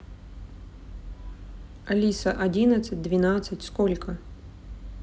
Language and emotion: Russian, neutral